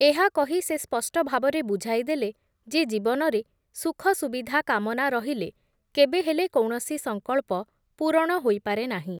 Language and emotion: Odia, neutral